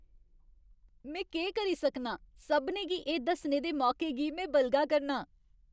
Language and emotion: Dogri, happy